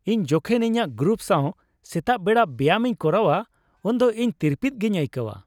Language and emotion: Santali, happy